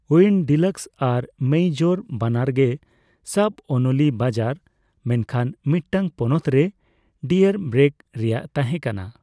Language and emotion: Santali, neutral